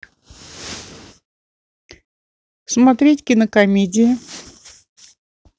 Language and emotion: Russian, neutral